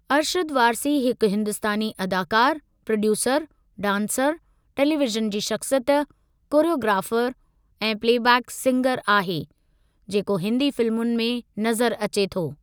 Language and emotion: Sindhi, neutral